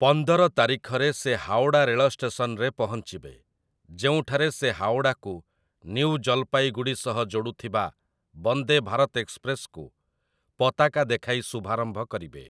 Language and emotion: Odia, neutral